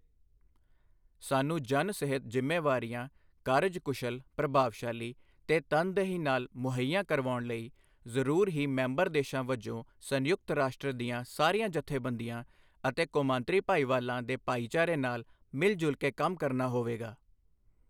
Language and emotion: Punjabi, neutral